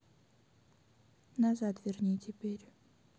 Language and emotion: Russian, neutral